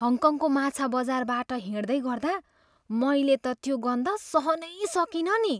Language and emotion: Nepali, disgusted